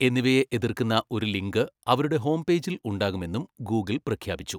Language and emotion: Malayalam, neutral